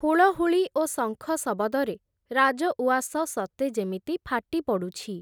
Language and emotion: Odia, neutral